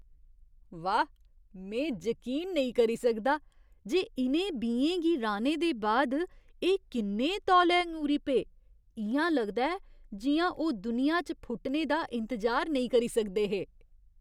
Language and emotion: Dogri, surprised